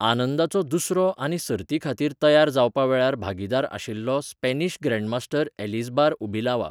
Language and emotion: Goan Konkani, neutral